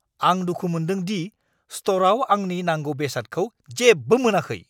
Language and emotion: Bodo, angry